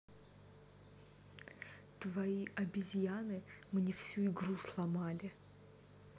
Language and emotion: Russian, angry